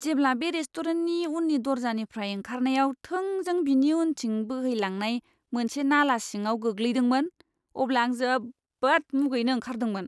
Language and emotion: Bodo, disgusted